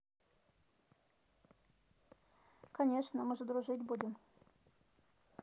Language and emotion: Russian, neutral